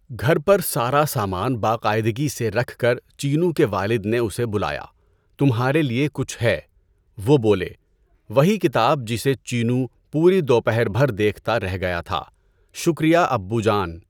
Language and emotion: Urdu, neutral